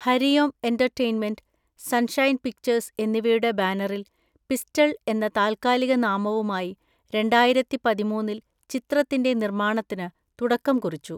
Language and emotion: Malayalam, neutral